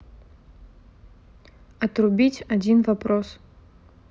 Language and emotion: Russian, neutral